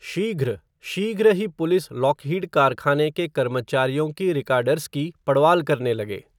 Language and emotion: Hindi, neutral